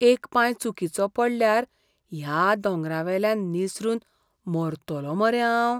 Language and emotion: Goan Konkani, fearful